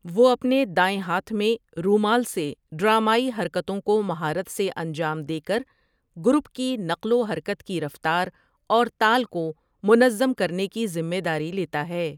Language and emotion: Urdu, neutral